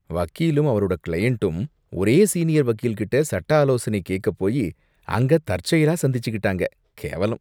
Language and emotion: Tamil, disgusted